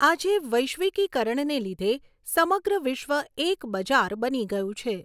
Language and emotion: Gujarati, neutral